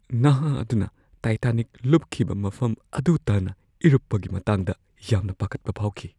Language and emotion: Manipuri, fearful